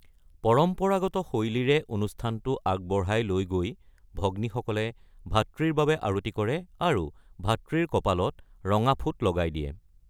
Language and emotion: Assamese, neutral